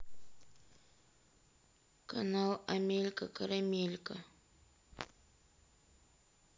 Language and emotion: Russian, sad